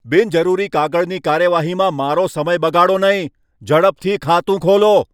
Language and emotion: Gujarati, angry